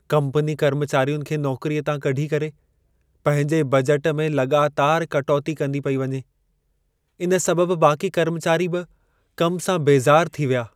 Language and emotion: Sindhi, sad